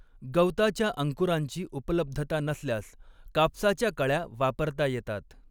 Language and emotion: Marathi, neutral